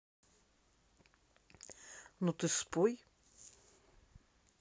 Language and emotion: Russian, neutral